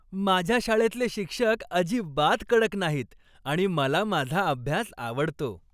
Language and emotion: Marathi, happy